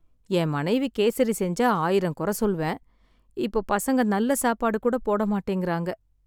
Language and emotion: Tamil, sad